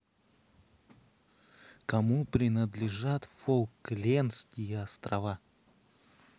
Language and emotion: Russian, neutral